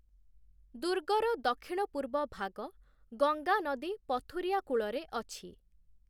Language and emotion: Odia, neutral